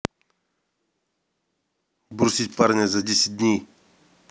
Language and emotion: Russian, neutral